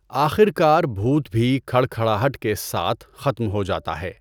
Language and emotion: Urdu, neutral